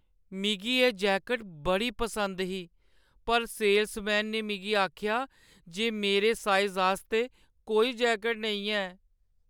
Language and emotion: Dogri, sad